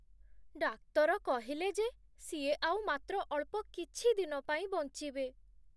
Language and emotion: Odia, sad